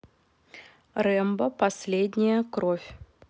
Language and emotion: Russian, neutral